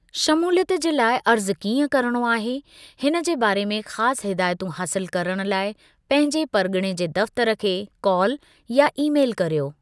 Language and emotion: Sindhi, neutral